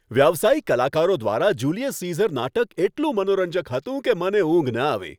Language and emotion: Gujarati, happy